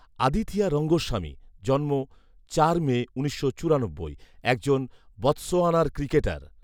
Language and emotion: Bengali, neutral